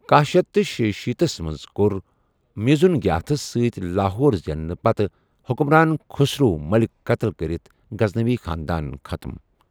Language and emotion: Kashmiri, neutral